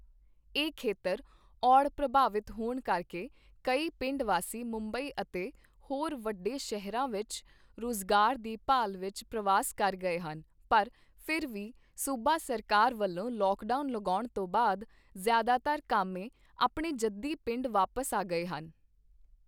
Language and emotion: Punjabi, neutral